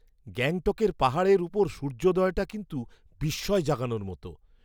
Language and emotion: Bengali, surprised